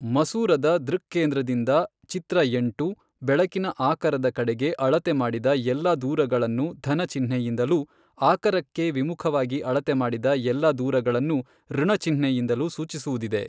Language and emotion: Kannada, neutral